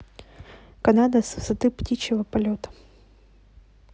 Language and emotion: Russian, neutral